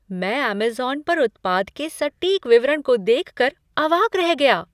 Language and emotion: Hindi, surprised